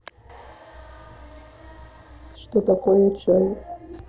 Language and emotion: Russian, neutral